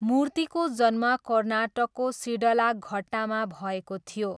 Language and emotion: Nepali, neutral